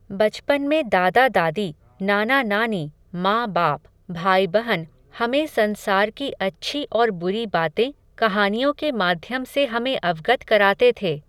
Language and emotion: Hindi, neutral